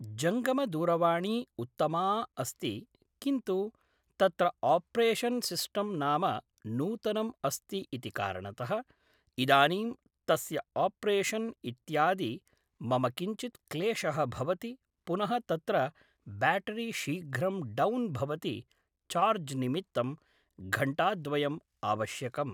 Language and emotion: Sanskrit, neutral